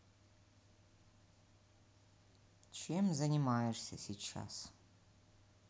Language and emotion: Russian, neutral